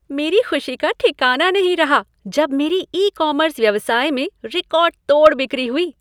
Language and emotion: Hindi, happy